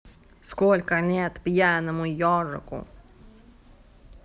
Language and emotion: Russian, neutral